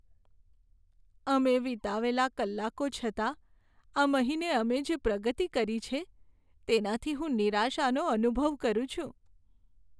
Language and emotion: Gujarati, sad